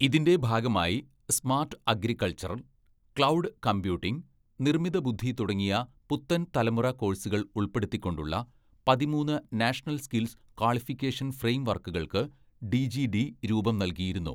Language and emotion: Malayalam, neutral